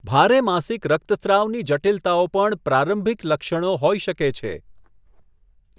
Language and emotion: Gujarati, neutral